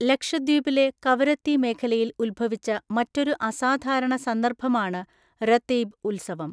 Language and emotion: Malayalam, neutral